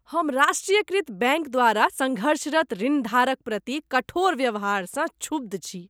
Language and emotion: Maithili, disgusted